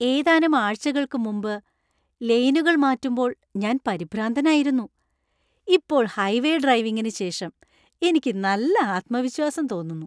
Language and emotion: Malayalam, happy